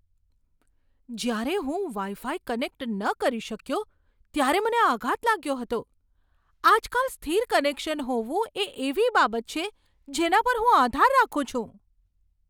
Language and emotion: Gujarati, surprised